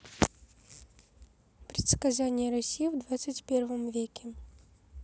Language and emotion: Russian, neutral